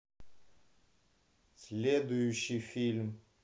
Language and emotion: Russian, neutral